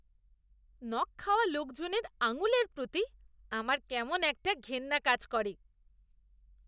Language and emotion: Bengali, disgusted